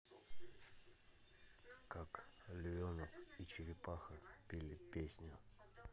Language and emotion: Russian, neutral